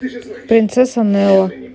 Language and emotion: Russian, neutral